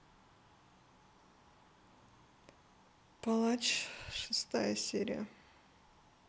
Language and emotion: Russian, sad